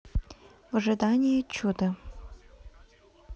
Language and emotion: Russian, neutral